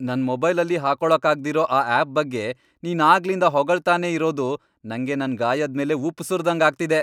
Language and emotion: Kannada, angry